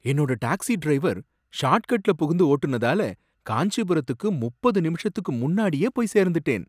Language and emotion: Tamil, surprised